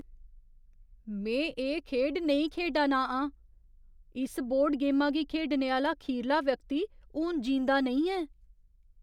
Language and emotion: Dogri, fearful